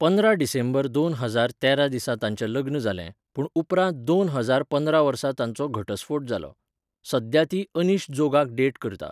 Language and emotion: Goan Konkani, neutral